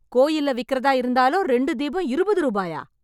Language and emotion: Tamil, angry